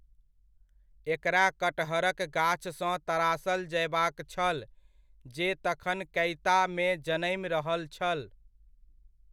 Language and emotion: Maithili, neutral